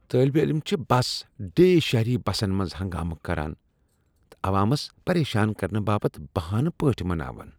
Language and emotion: Kashmiri, disgusted